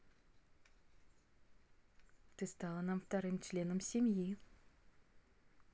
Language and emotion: Russian, positive